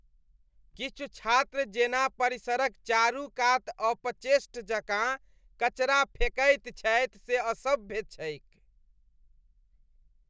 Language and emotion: Maithili, disgusted